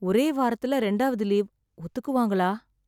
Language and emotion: Tamil, sad